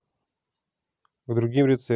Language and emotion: Russian, neutral